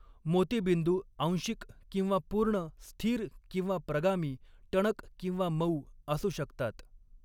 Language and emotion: Marathi, neutral